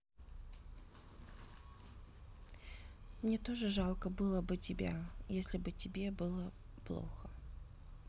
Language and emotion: Russian, sad